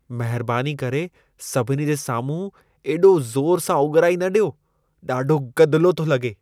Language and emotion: Sindhi, disgusted